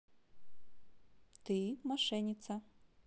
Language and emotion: Russian, positive